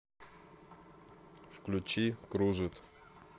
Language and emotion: Russian, neutral